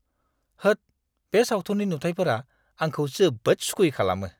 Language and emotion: Bodo, disgusted